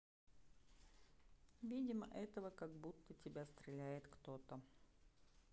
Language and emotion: Russian, neutral